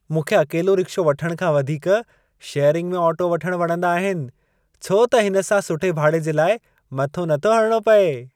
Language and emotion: Sindhi, happy